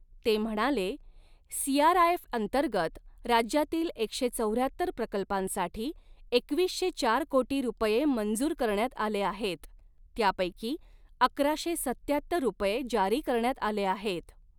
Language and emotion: Marathi, neutral